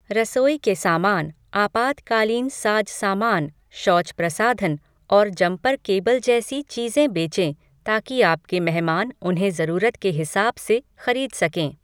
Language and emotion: Hindi, neutral